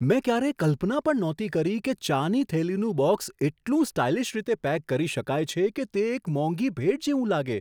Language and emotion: Gujarati, surprised